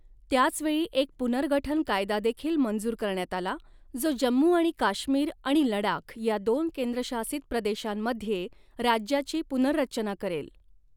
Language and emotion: Marathi, neutral